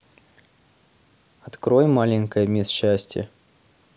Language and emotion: Russian, neutral